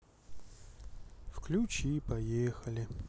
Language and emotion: Russian, sad